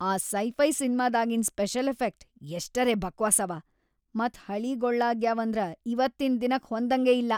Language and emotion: Kannada, disgusted